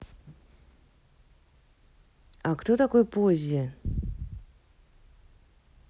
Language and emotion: Russian, neutral